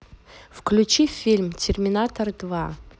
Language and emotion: Russian, neutral